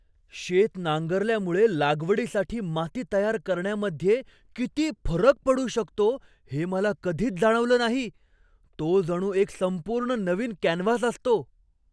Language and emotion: Marathi, surprised